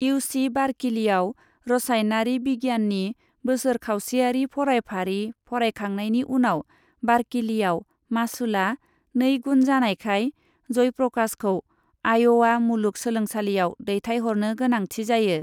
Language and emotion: Bodo, neutral